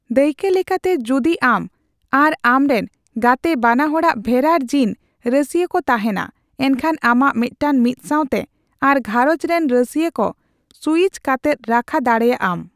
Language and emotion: Santali, neutral